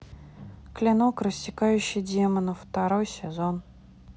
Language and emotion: Russian, neutral